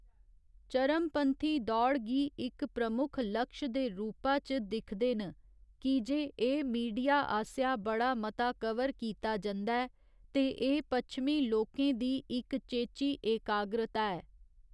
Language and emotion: Dogri, neutral